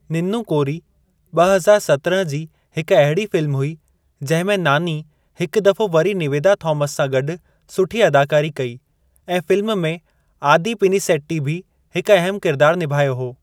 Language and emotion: Sindhi, neutral